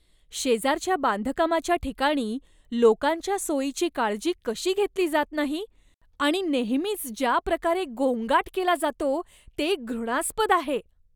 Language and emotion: Marathi, disgusted